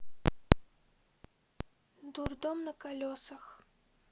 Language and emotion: Russian, neutral